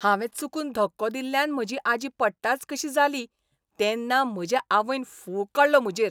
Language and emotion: Goan Konkani, angry